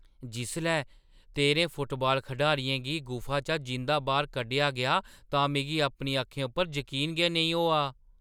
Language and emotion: Dogri, surprised